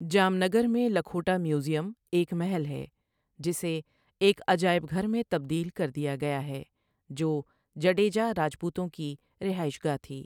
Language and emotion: Urdu, neutral